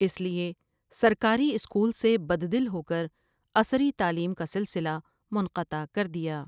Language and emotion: Urdu, neutral